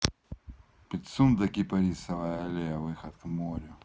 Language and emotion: Russian, neutral